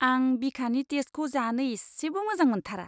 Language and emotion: Bodo, disgusted